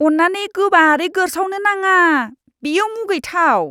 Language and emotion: Bodo, disgusted